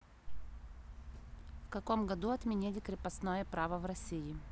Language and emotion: Russian, neutral